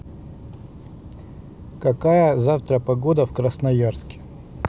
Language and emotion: Russian, neutral